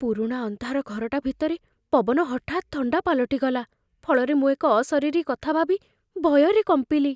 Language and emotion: Odia, fearful